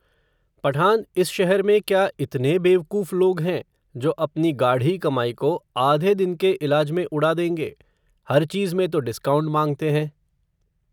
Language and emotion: Hindi, neutral